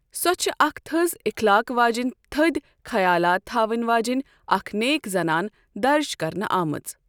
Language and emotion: Kashmiri, neutral